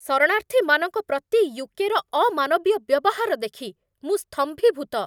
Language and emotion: Odia, angry